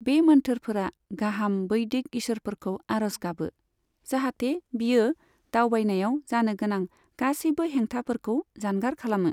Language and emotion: Bodo, neutral